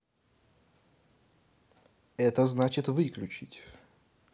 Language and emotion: Russian, neutral